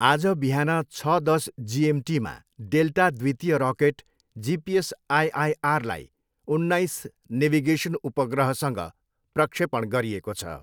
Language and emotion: Nepali, neutral